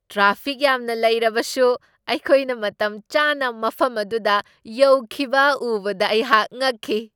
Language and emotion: Manipuri, surprised